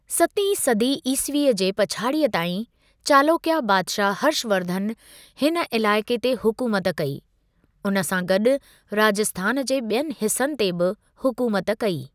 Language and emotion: Sindhi, neutral